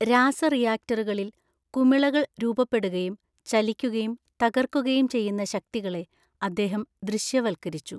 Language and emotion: Malayalam, neutral